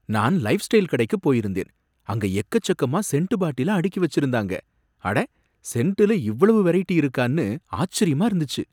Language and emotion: Tamil, surprised